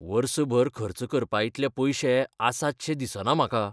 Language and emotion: Goan Konkani, fearful